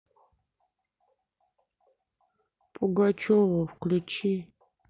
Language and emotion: Russian, sad